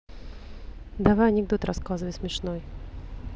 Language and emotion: Russian, neutral